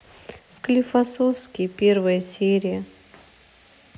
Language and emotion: Russian, sad